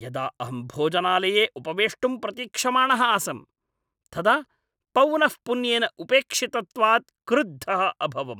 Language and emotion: Sanskrit, angry